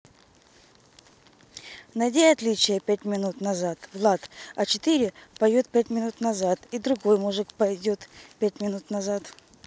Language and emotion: Russian, neutral